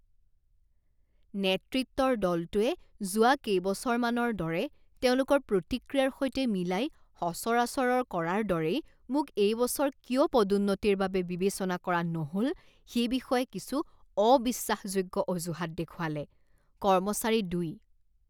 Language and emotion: Assamese, disgusted